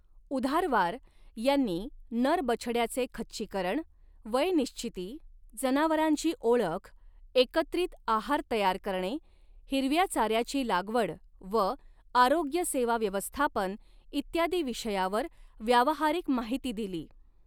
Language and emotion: Marathi, neutral